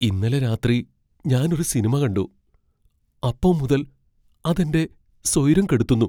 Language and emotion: Malayalam, fearful